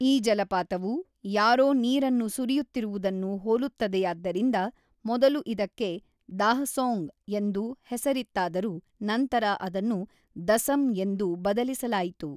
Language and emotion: Kannada, neutral